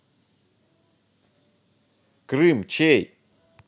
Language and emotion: Russian, angry